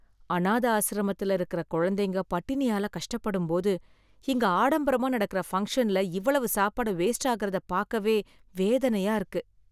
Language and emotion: Tamil, sad